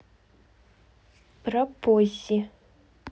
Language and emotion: Russian, neutral